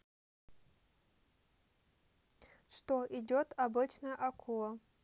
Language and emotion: Russian, neutral